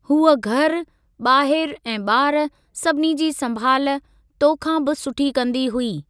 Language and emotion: Sindhi, neutral